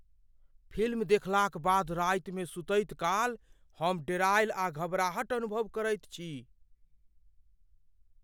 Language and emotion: Maithili, fearful